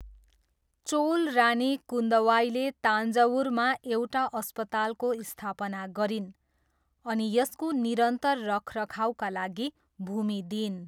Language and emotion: Nepali, neutral